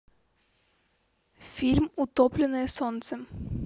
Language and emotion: Russian, neutral